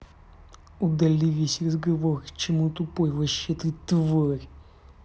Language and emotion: Russian, angry